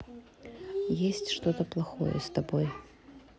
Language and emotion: Russian, neutral